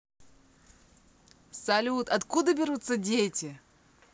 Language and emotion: Russian, positive